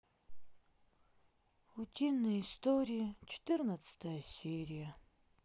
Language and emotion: Russian, sad